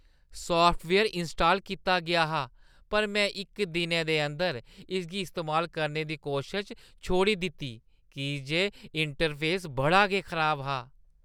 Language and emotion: Dogri, disgusted